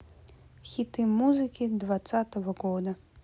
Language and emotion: Russian, neutral